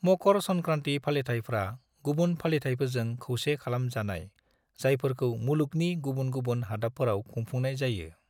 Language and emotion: Bodo, neutral